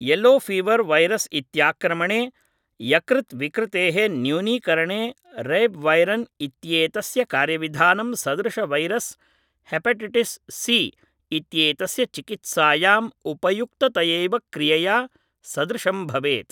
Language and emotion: Sanskrit, neutral